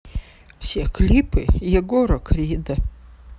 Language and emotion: Russian, sad